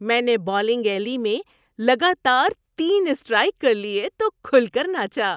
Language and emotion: Urdu, happy